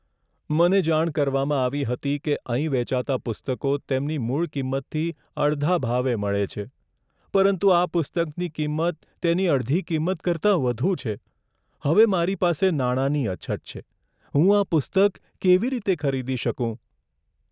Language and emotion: Gujarati, sad